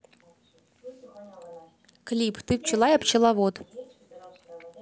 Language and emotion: Russian, neutral